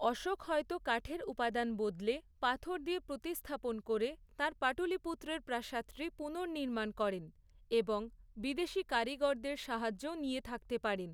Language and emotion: Bengali, neutral